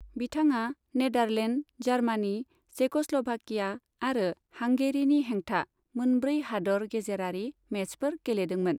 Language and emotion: Bodo, neutral